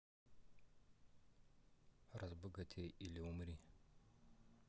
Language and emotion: Russian, neutral